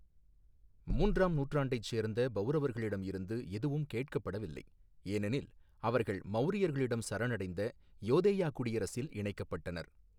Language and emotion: Tamil, neutral